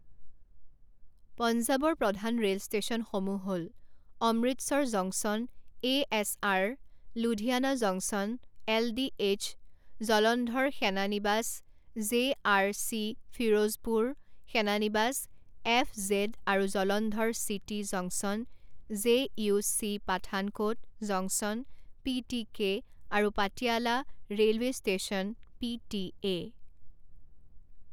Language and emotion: Assamese, neutral